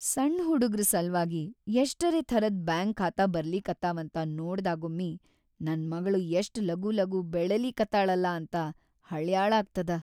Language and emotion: Kannada, sad